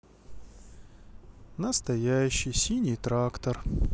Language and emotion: Russian, sad